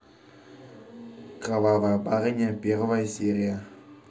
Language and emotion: Russian, neutral